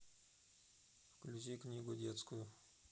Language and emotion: Russian, neutral